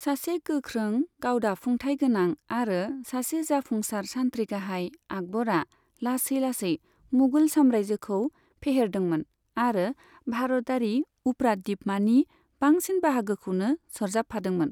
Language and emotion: Bodo, neutral